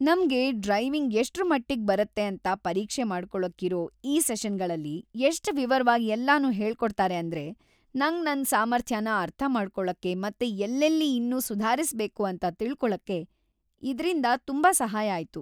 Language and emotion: Kannada, happy